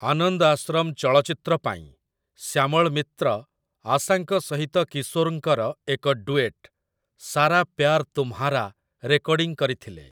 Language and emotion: Odia, neutral